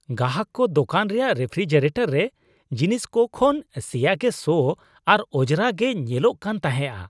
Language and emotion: Santali, disgusted